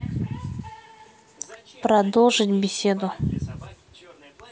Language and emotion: Russian, neutral